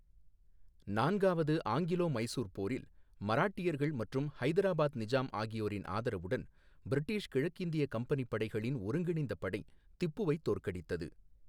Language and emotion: Tamil, neutral